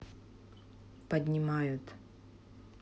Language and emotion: Russian, neutral